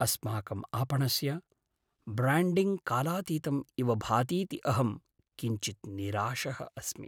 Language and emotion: Sanskrit, sad